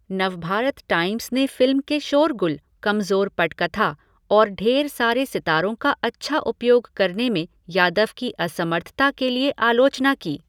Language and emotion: Hindi, neutral